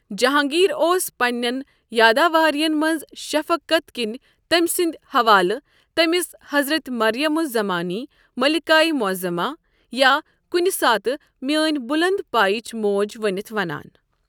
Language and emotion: Kashmiri, neutral